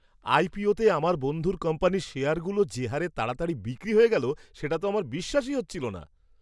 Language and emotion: Bengali, surprised